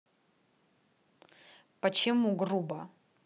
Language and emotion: Russian, angry